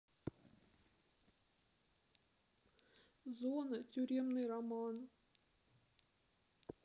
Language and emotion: Russian, sad